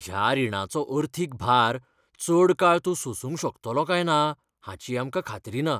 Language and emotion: Goan Konkani, fearful